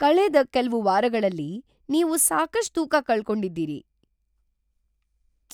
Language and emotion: Kannada, surprised